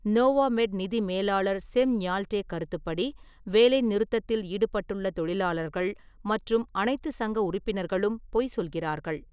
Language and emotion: Tamil, neutral